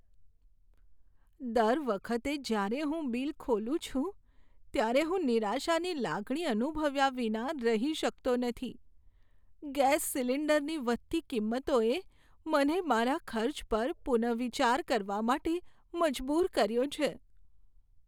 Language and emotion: Gujarati, sad